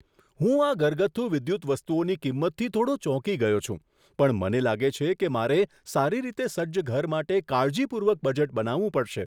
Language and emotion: Gujarati, surprised